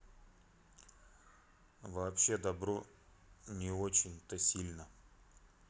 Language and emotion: Russian, neutral